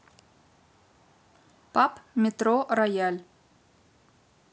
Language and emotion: Russian, neutral